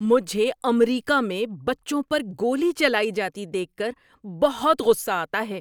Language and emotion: Urdu, angry